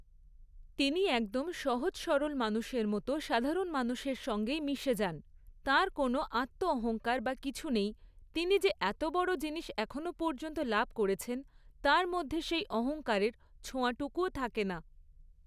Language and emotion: Bengali, neutral